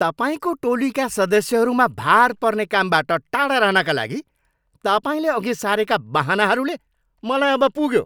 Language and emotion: Nepali, angry